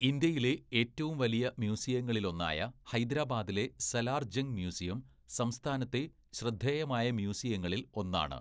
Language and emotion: Malayalam, neutral